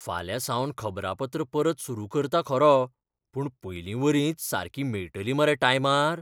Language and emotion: Goan Konkani, fearful